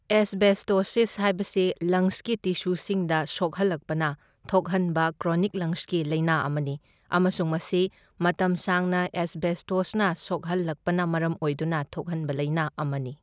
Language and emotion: Manipuri, neutral